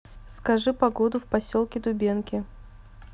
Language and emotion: Russian, neutral